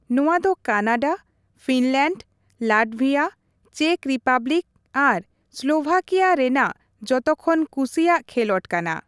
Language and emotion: Santali, neutral